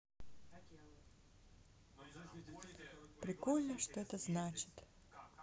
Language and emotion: Russian, sad